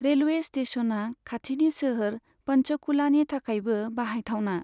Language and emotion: Bodo, neutral